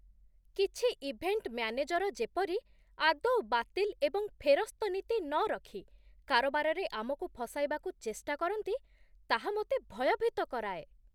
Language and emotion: Odia, disgusted